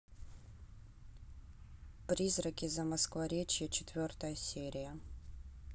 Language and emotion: Russian, neutral